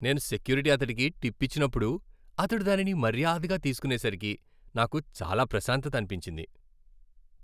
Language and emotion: Telugu, happy